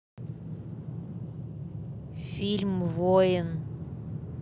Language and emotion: Russian, neutral